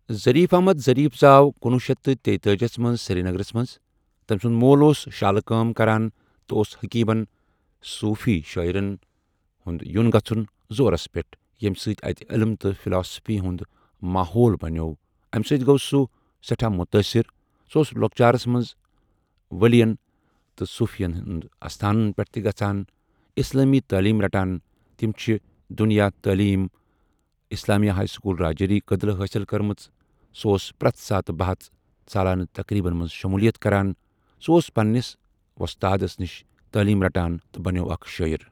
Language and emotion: Kashmiri, neutral